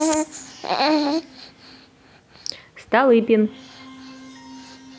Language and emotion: Russian, neutral